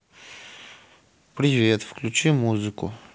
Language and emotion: Russian, neutral